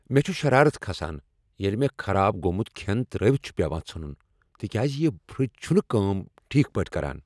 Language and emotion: Kashmiri, angry